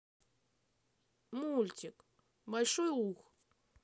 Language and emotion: Russian, sad